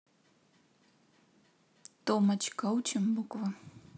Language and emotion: Russian, neutral